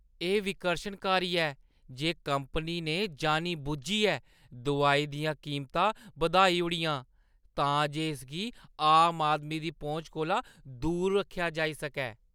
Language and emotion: Dogri, disgusted